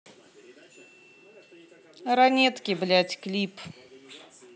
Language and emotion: Russian, angry